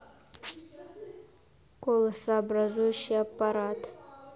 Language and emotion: Russian, neutral